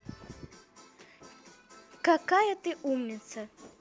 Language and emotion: Russian, positive